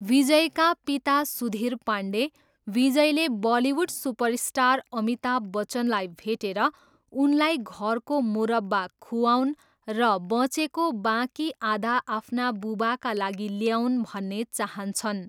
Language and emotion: Nepali, neutral